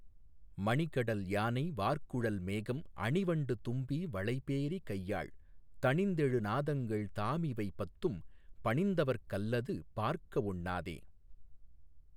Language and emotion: Tamil, neutral